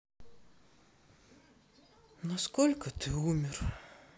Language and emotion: Russian, sad